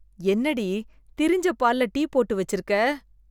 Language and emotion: Tamil, disgusted